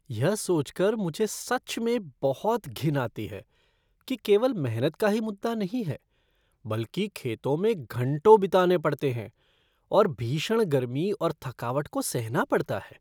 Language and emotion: Hindi, disgusted